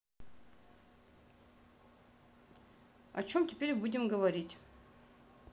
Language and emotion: Russian, neutral